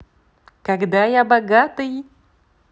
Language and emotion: Russian, positive